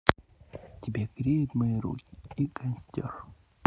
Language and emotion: Russian, neutral